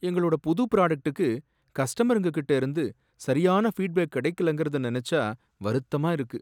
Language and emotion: Tamil, sad